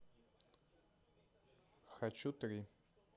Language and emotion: Russian, neutral